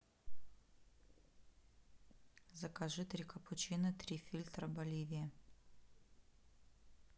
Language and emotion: Russian, neutral